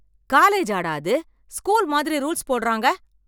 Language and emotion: Tamil, angry